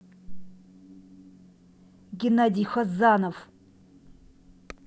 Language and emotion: Russian, angry